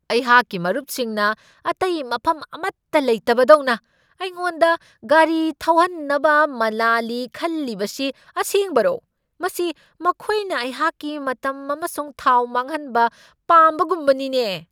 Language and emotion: Manipuri, angry